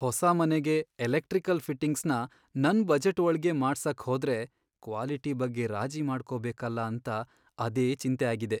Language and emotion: Kannada, sad